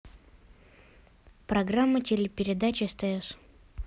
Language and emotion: Russian, neutral